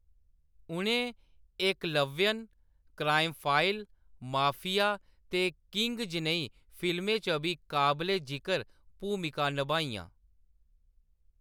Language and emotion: Dogri, neutral